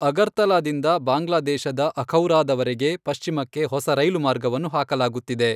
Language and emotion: Kannada, neutral